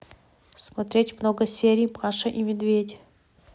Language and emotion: Russian, neutral